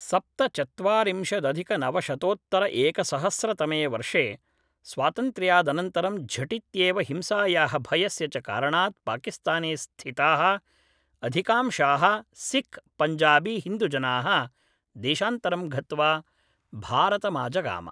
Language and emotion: Sanskrit, neutral